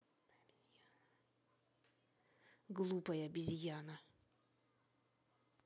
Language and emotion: Russian, angry